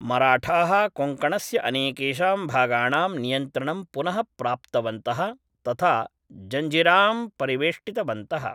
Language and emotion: Sanskrit, neutral